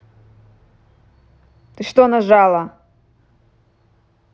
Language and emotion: Russian, angry